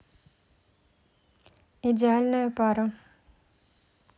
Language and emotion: Russian, neutral